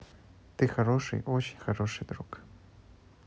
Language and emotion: Russian, neutral